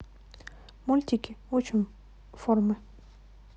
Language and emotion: Russian, neutral